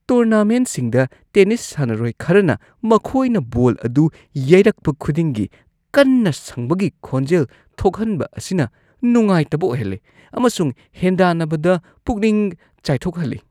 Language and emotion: Manipuri, disgusted